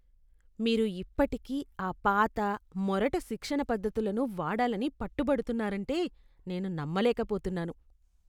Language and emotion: Telugu, disgusted